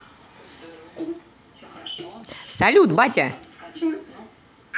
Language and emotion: Russian, positive